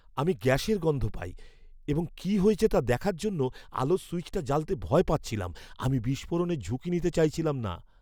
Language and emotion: Bengali, fearful